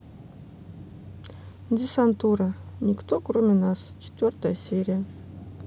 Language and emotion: Russian, neutral